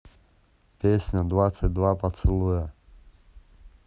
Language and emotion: Russian, neutral